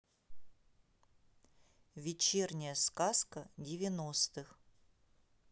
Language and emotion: Russian, neutral